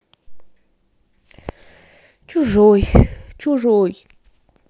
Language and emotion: Russian, sad